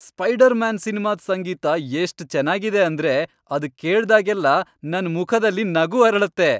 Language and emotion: Kannada, happy